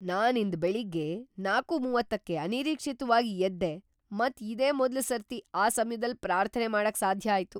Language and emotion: Kannada, surprised